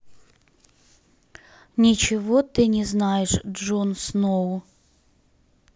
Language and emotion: Russian, neutral